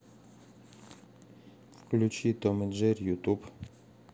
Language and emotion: Russian, neutral